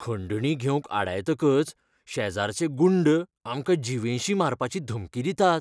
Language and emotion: Goan Konkani, fearful